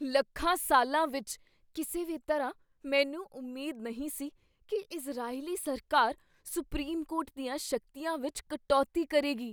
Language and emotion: Punjabi, surprised